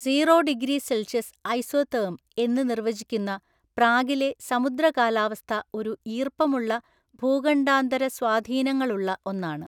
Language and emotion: Malayalam, neutral